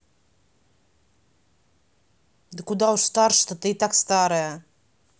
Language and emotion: Russian, neutral